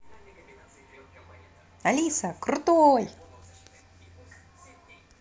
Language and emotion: Russian, positive